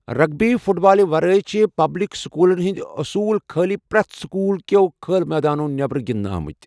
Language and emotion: Kashmiri, neutral